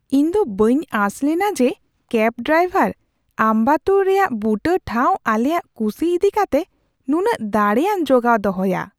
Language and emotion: Santali, surprised